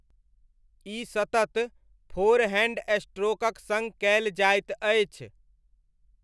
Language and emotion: Maithili, neutral